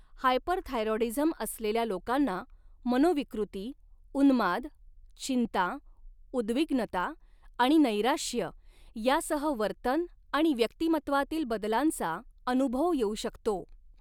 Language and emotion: Marathi, neutral